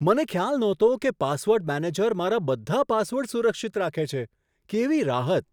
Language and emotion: Gujarati, surprised